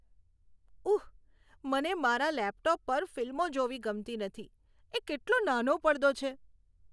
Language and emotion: Gujarati, disgusted